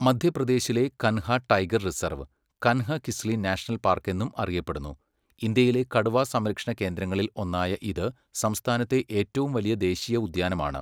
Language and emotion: Malayalam, neutral